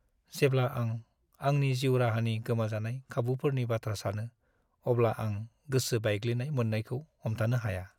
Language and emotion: Bodo, sad